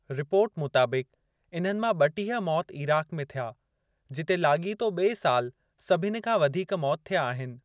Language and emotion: Sindhi, neutral